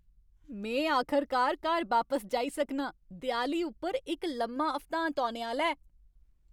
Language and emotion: Dogri, happy